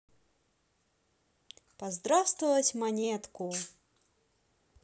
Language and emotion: Russian, positive